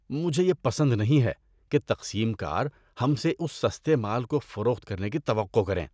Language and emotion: Urdu, disgusted